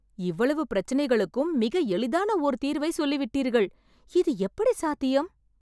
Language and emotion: Tamil, surprised